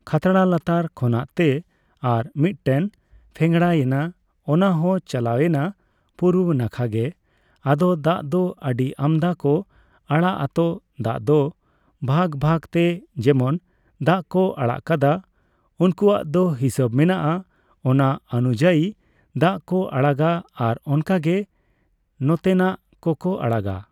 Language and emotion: Santali, neutral